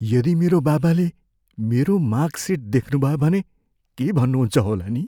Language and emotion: Nepali, fearful